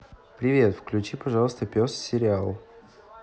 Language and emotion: Russian, neutral